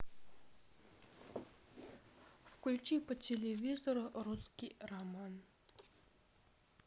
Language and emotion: Russian, neutral